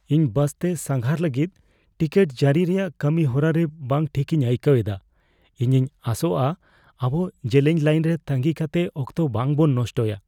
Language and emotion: Santali, fearful